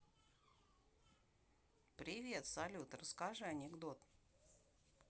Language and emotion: Russian, neutral